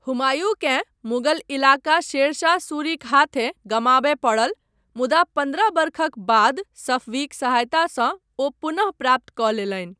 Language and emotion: Maithili, neutral